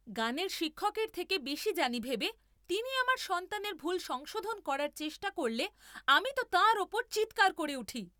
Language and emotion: Bengali, angry